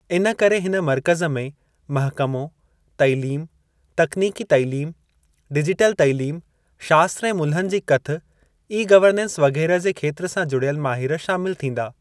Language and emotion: Sindhi, neutral